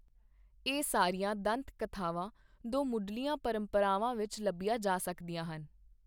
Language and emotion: Punjabi, neutral